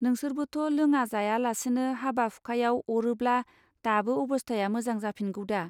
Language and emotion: Bodo, neutral